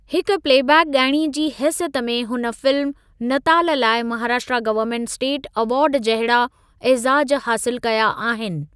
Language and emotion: Sindhi, neutral